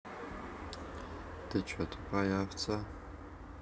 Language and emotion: Russian, neutral